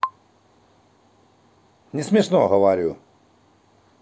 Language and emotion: Russian, angry